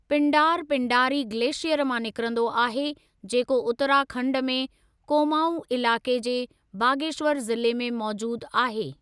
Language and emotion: Sindhi, neutral